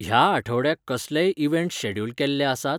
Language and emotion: Goan Konkani, neutral